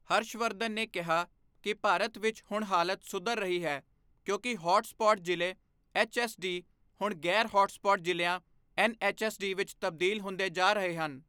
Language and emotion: Punjabi, neutral